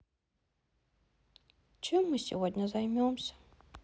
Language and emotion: Russian, sad